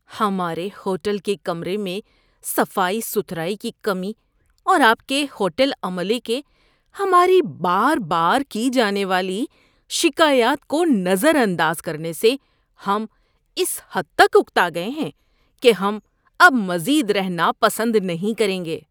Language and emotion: Urdu, disgusted